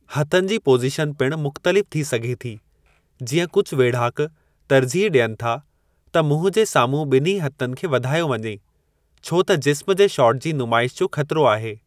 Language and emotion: Sindhi, neutral